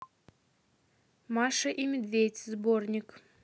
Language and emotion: Russian, neutral